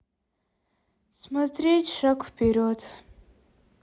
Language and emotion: Russian, sad